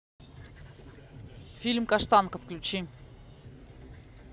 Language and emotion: Russian, neutral